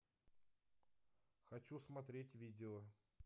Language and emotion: Russian, neutral